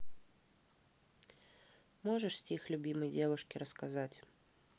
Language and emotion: Russian, neutral